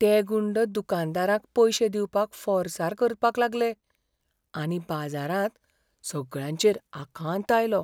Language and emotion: Goan Konkani, fearful